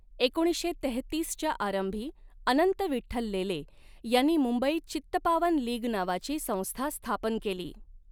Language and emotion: Marathi, neutral